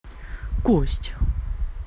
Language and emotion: Russian, neutral